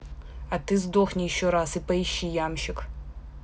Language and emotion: Russian, angry